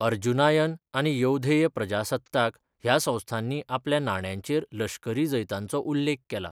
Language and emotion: Goan Konkani, neutral